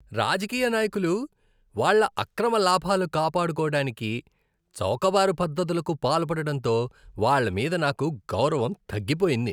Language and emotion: Telugu, disgusted